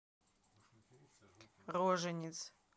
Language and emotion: Russian, neutral